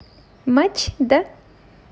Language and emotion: Russian, positive